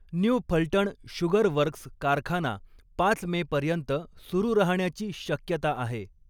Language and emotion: Marathi, neutral